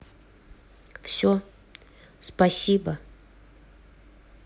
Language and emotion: Russian, neutral